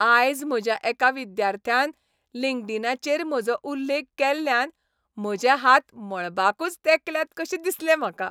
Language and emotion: Goan Konkani, happy